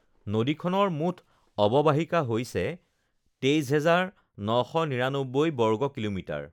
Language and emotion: Assamese, neutral